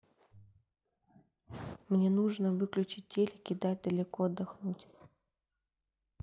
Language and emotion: Russian, neutral